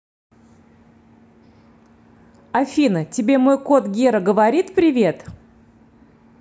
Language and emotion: Russian, neutral